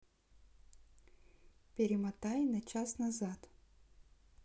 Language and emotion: Russian, neutral